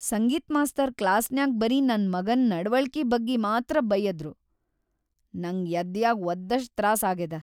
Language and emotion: Kannada, sad